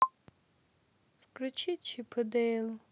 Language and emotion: Russian, sad